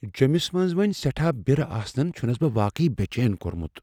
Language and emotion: Kashmiri, fearful